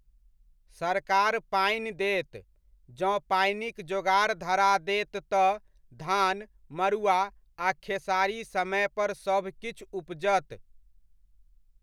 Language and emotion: Maithili, neutral